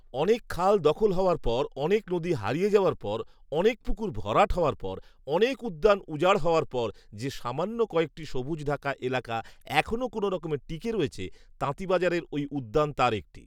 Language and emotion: Bengali, neutral